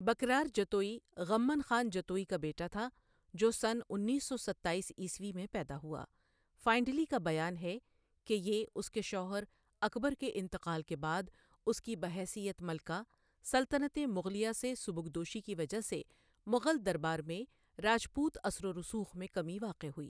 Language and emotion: Urdu, neutral